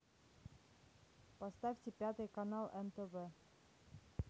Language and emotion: Russian, neutral